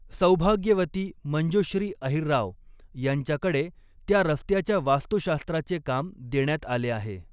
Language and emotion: Marathi, neutral